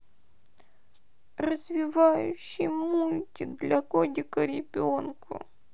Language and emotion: Russian, sad